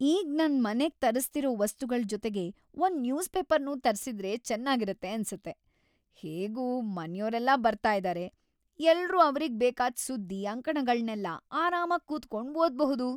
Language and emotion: Kannada, happy